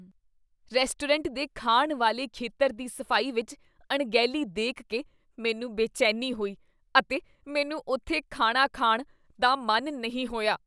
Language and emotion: Punjabi, disgusted